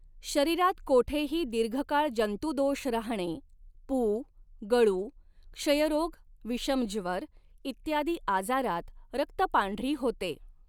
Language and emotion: Marathi, neutral